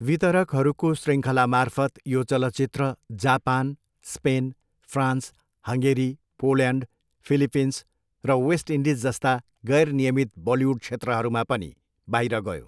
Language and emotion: Nepali, neutral